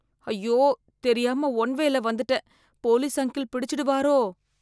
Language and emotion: Tamil, fearful